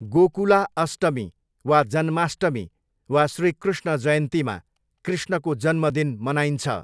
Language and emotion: Nepali, neutral